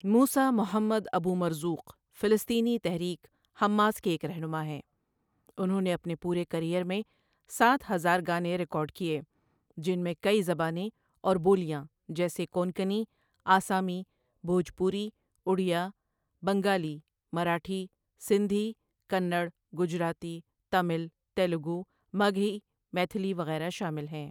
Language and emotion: Urdu, neutral